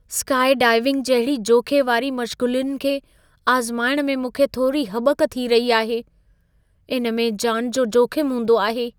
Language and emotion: Sindhi, fearful